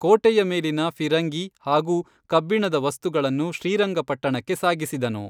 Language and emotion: Kannada, neutral